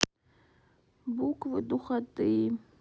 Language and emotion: Russian, sad